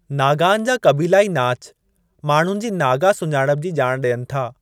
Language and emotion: Sindhi, neutral